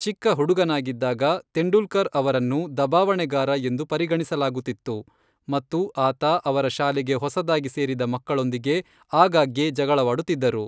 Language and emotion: Kannada, neutral